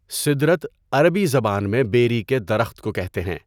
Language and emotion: Urdu, neutral